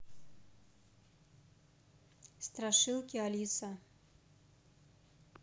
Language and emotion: Russian, neutral